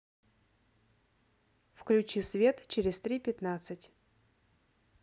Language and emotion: Russian, neutral